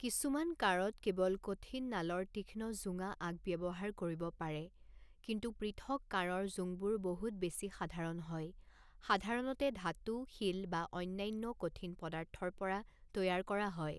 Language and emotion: Assamese, neutral